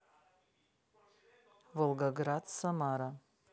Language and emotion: Russian, neutral